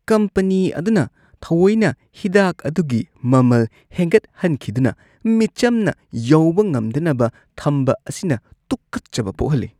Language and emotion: Manipuri, disgusted